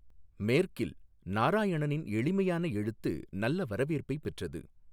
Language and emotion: Tamil, neutral